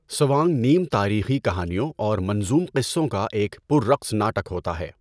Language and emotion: Urdu, neutral